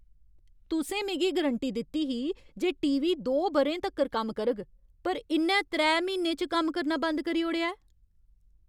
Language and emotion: Dogri, angry